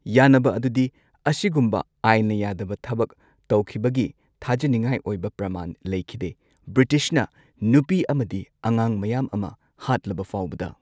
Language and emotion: Manipuri, neutral